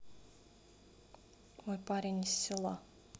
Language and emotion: Russian, neutral